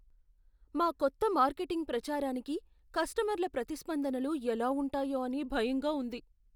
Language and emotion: Telugu, fearful